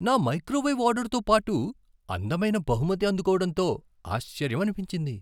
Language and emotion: Telugu, surprised